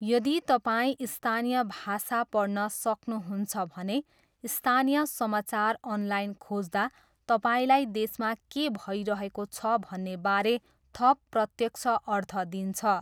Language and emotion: Nepali, neutral